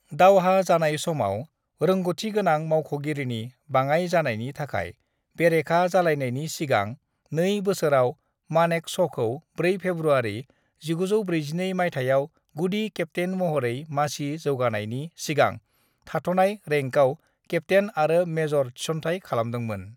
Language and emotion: Bodo, neutral